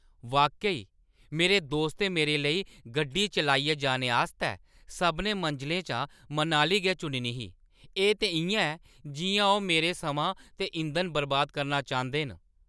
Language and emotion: Dogri, angry